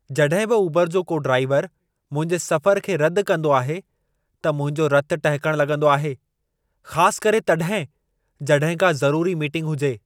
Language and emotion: Sindhi, angry